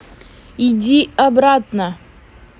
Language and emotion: Russian, angry